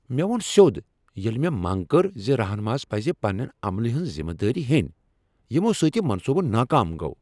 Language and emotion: Kashmiri, angry